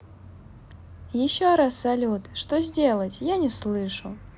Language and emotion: Russian, positive